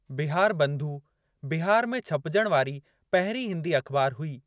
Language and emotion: Sindhi, neutral